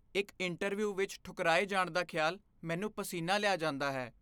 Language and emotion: Punjabi, fearful